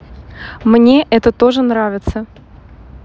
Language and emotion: Russian, neutral